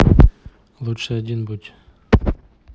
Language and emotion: Russian, neutral